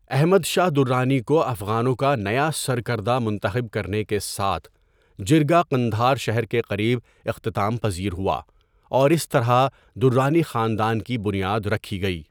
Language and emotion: Urdu, neutral